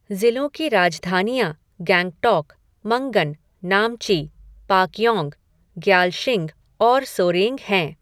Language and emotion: Hindi, neutral